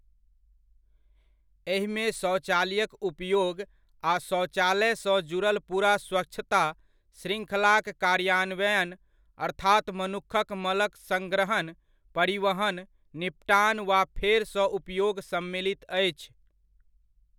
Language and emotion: Maithili, neutral